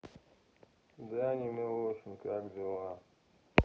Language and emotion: Russian, sad